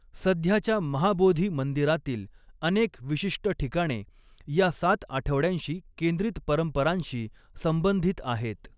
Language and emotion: Marathi, neutral